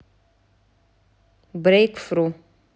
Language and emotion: Russian, neutral